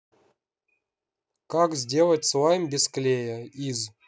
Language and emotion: Russian, neutral